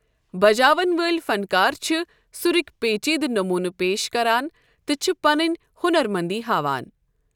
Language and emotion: Kashmiri, neutral